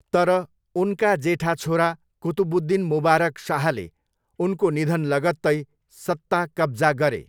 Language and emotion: Nepali, neutral